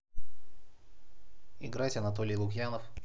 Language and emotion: Russian, neutral